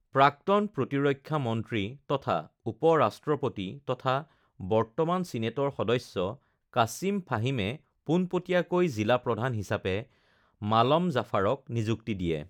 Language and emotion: Assamese, neutral